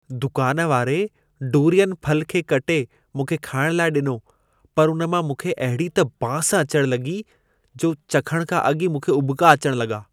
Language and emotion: Sindhi, disgusted